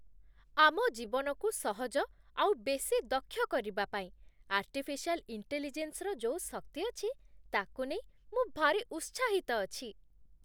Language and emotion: Odia, happy